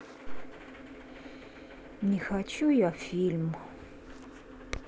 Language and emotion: Russian, sad